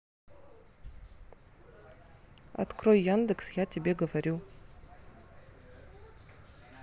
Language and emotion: Russian, neutral